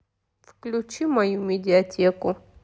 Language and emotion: Russian, sad